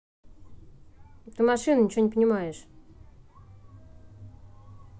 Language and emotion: Russian, angry